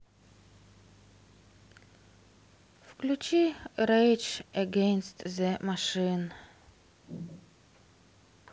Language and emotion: Russian, sad